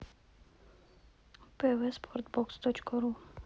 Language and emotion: Russian, neutral